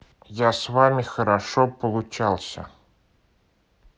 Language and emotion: Russian, neutral